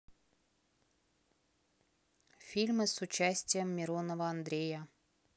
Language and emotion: Russian, neutral